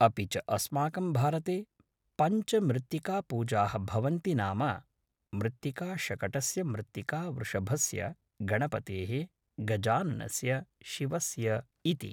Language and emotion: Sanskrit, neutral